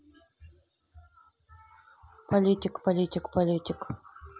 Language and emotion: Russian, neutral